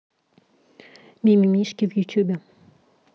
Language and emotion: Russian, neutral